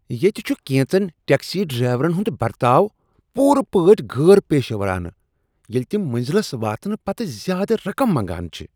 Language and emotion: Kashmiri, disgusted